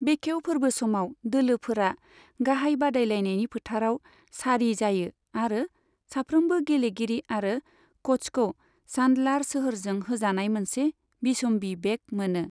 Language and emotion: Bodo, neutral